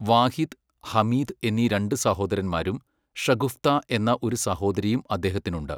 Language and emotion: Malayalam, neutral